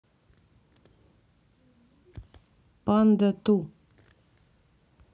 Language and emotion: Russian, neutral